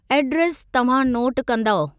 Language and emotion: Sindhi, neutral